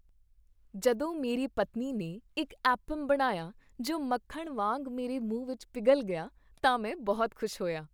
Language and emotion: Punjabi, happy